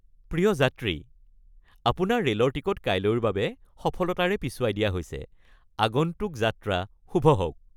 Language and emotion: Assamese, happy